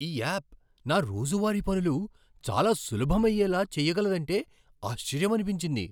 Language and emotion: Telugu, surprised